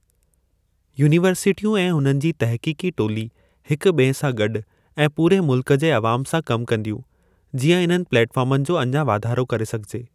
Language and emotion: Sindhi, neutral